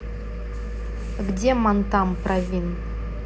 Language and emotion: Russian, neutral